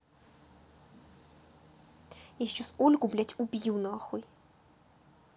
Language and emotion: Russian, angry